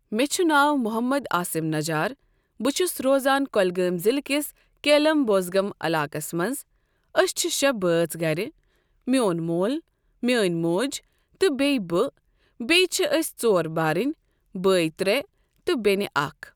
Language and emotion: Kashmiri, neutral